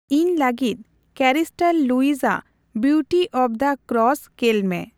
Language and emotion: Santali, neutral